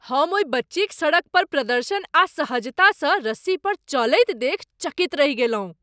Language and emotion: Maithili, surprised